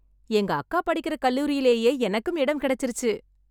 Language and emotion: Tamil, happy